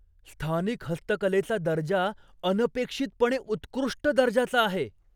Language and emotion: Marathi, surprised